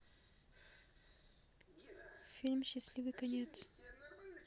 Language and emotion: Russian, neutral